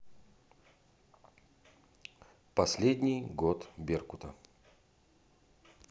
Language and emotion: Russian, neutral